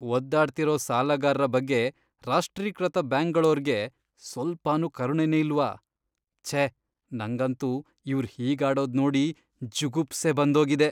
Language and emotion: Kannada, disgusted